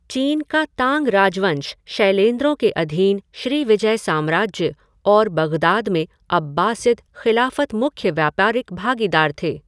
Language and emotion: Hindi, neutral